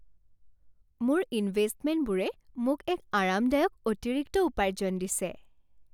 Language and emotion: Assamese, happy